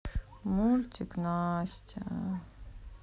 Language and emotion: Russian, sad